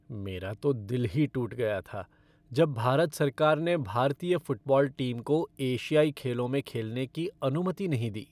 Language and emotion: Hindi, sad